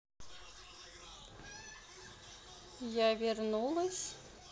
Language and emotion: Russian, neutral